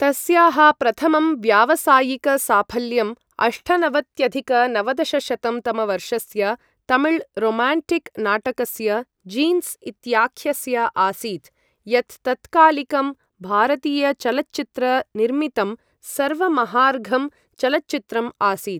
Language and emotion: Sanskrit, neutral